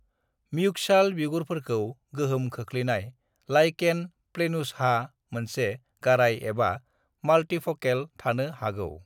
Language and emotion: Bodo, neutral